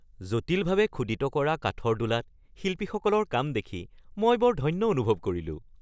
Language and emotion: Assamese, happy